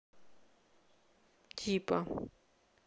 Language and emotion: Russian, neutral